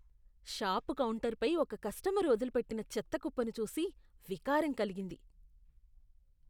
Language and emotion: Telugu, disgusted